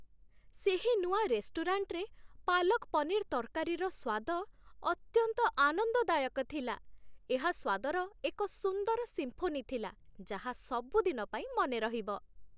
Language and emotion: Odia, happy